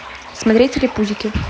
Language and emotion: Russian, neutral